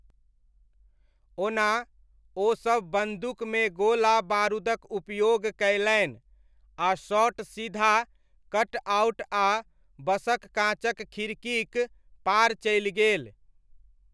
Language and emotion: Maithili, neutral